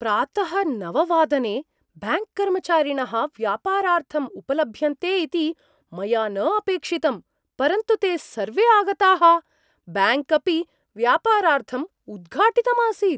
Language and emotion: Sanskrit, surprised